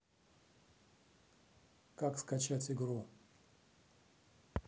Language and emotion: Russian, neutral